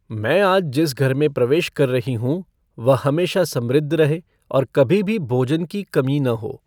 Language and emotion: Hindi, neutral